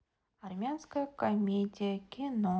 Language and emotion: Russian, neutral